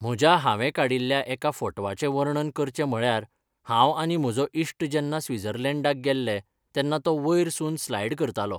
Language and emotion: Goan Konkani, neutral